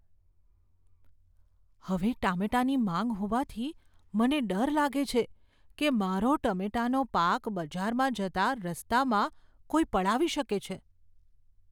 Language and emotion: Gujarati, fearful